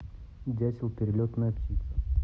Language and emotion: Russian, neutral